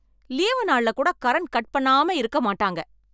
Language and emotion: Tamil, angry